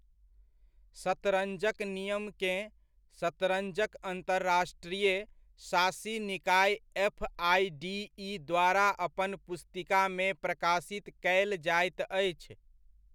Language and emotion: Maithili, neutral